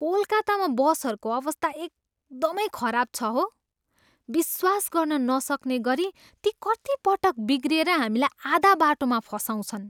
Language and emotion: Nepali, disgusted